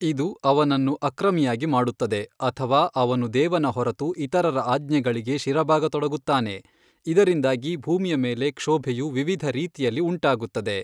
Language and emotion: Kannada, neutral